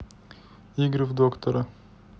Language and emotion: Russian, neutral